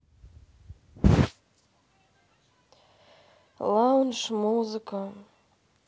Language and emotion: Russian, sad